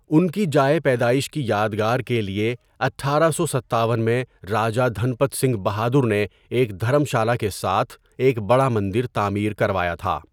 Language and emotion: Urdu, neutral